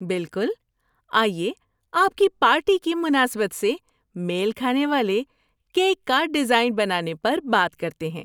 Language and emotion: Urdu, happy